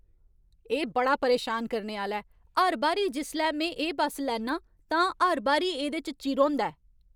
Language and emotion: Dogri, angry